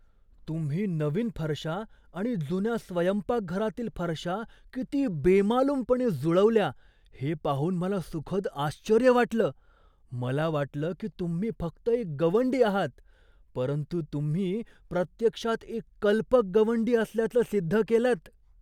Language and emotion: Marathi, surprised